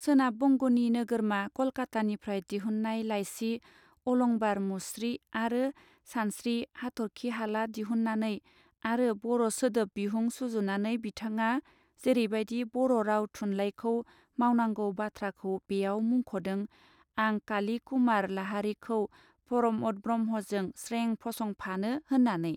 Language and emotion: Bodo, neutral